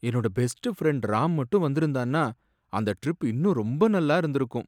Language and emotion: Tamil, sad